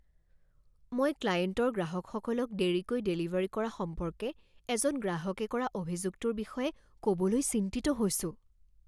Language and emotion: Assamese, fearful